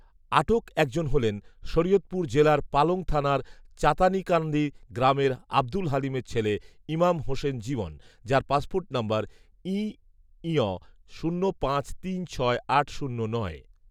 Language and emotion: Bengali, neutral